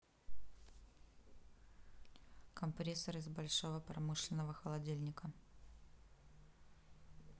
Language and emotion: Russian, neutral